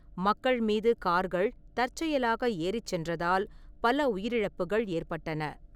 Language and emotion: Tamil, neutral